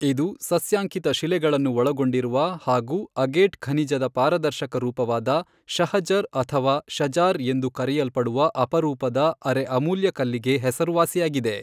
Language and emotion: Kannada, neutral